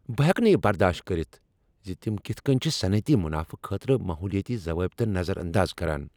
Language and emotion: Kashmiri, angry